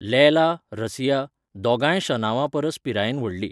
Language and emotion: Goan Konkani, neutral